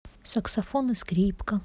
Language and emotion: Russian, neutral